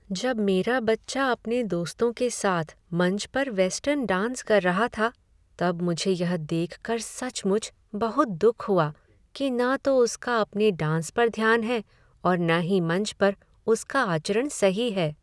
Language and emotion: Hindi, sad